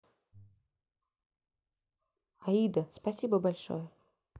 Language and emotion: Russian, positive